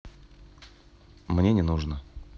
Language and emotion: Russian, neutral